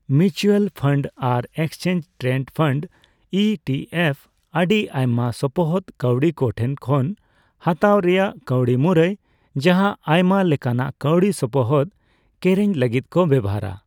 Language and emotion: Santali, neutral